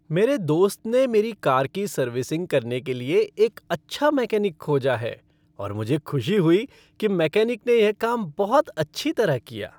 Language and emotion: Hindi, happy